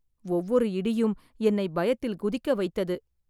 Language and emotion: Tamil, fearful